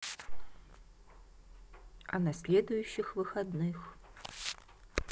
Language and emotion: Russian, neutral